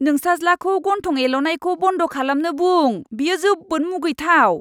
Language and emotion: Bodo, disgusted